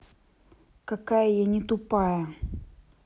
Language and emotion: Russian, angry